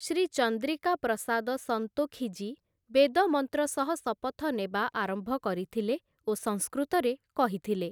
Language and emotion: Odia, neutral